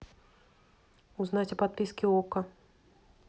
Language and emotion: Russian, neutral